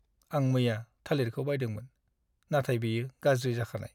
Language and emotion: Bodo, sad